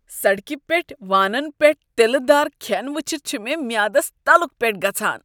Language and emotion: Kashmiri, disgusted